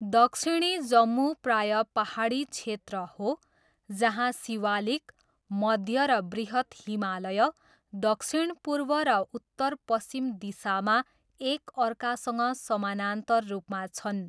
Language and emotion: Nepali, neutral